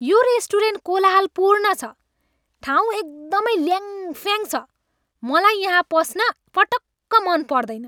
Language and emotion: Nepali, angry